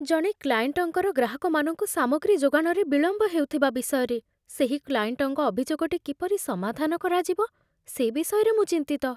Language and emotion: Odia, fearful